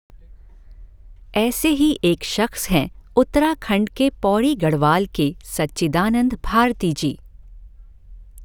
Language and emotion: Hindi, neutral